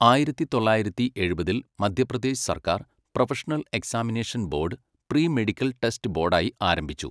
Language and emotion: Malayalam, neutral